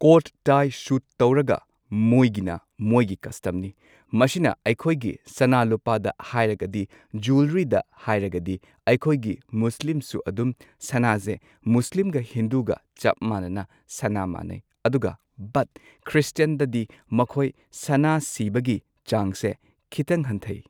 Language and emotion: Manipuri, neutral